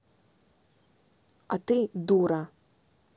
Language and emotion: Russian, angry